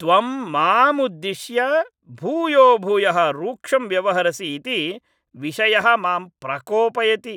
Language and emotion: Sanskrit, angry